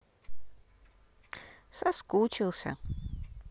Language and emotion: Russian, neutral